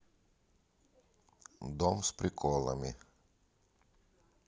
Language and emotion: Russian, neutral